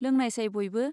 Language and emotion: Bodo, neutral